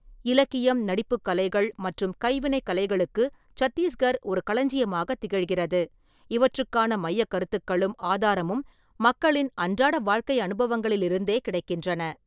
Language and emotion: Tamil, neutral